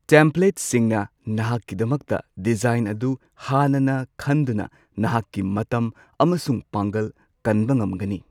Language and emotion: Manipuri, neutral